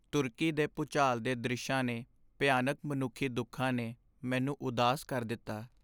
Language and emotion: Punjabi, sad